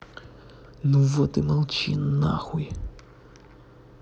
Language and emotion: Russian, angry